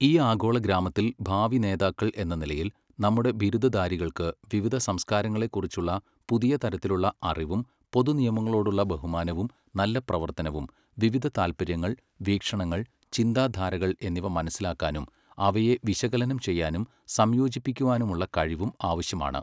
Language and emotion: Malayalam, neutral